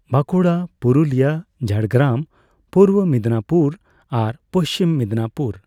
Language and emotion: Santali, neutral